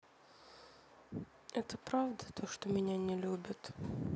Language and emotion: Russian, sad